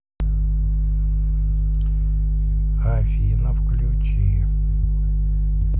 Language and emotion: Russian, neutral